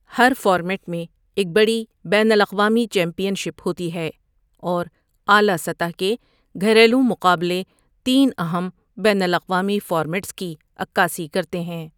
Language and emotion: Urdu, neutral